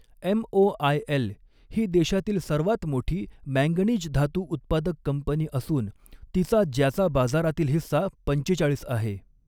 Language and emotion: Marathi, neutral